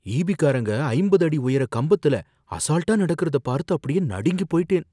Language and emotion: Tamil, fearful